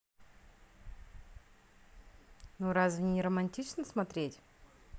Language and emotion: Russian, positive